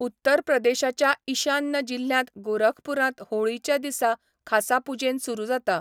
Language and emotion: Goan Konkani, neutral